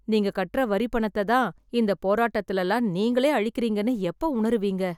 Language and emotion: Tamil, sad